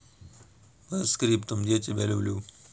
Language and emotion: Russian, neutral